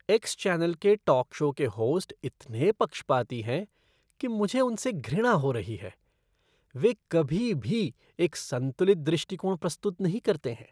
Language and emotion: Hindi, disgusted